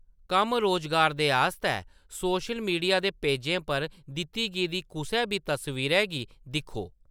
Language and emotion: Dogri, neutral